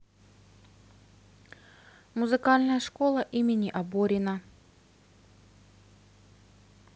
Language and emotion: Russian, neutral